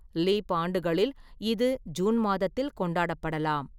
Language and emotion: Tamil, neutral